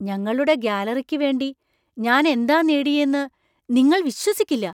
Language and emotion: Malayalam, surprised